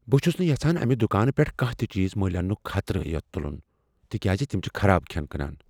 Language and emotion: Kashmiri, fearful